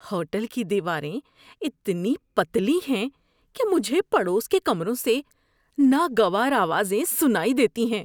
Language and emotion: Urdu, disgusted